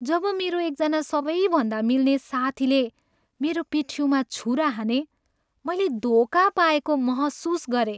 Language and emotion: Nepali, sad